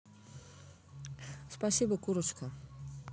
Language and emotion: Russian, positive